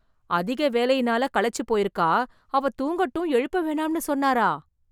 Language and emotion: Tamil, surprised